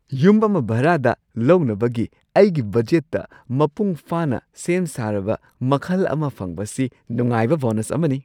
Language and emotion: Manipuri, surprised